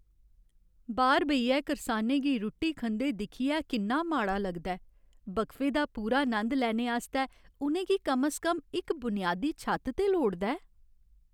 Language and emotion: Dogri, sad